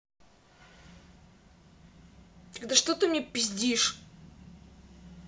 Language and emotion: Russian, angry